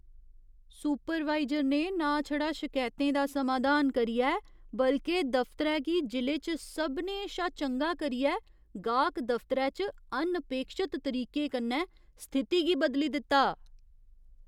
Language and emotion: Dogri, surprised